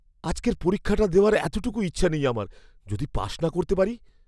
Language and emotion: Bengali, fearful